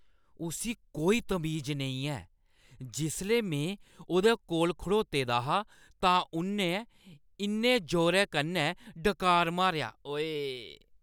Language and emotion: Dogri, disgusted